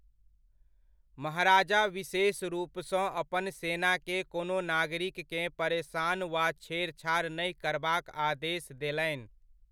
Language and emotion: Maithili, neutral